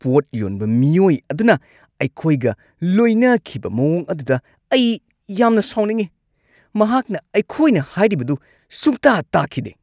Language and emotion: Manipuri, angry